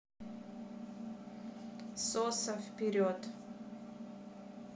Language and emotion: Russian, neutral